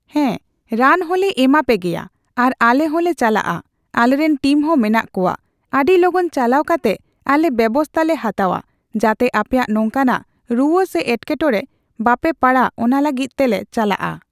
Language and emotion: Santali, neutral